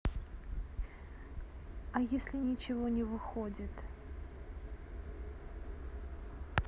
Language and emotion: Russian, neutral